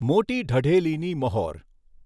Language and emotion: Gujarati, neutral